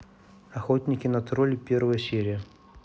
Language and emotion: Russian, neutral